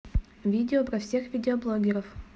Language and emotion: Russian, neutral